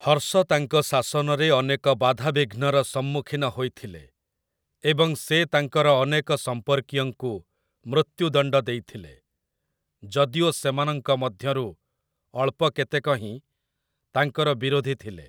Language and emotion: Odia, neutral